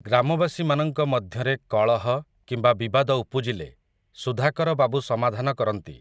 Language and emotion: Odia, neutral